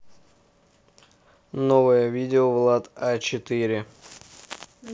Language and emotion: Russian, neutral